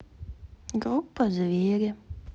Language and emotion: Russian, neutral